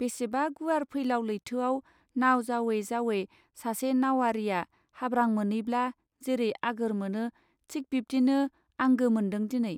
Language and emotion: Bodo, neutral